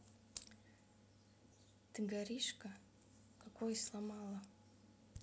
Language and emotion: Russian, neutral